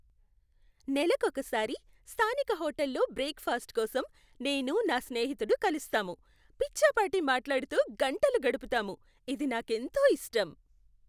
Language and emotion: Telugu, happy